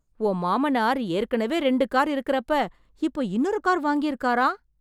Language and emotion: Tamil, surprised